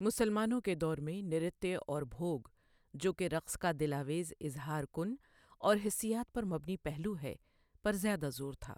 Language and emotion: Urdu, neutral